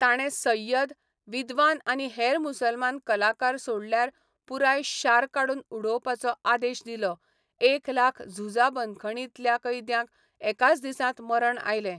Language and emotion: Goan Konkani, neutral